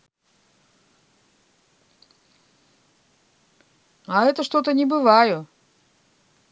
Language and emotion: Russian, neutral